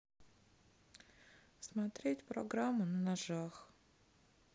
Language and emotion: Russian, sad